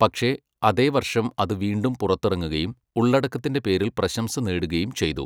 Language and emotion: Malayalam, neutral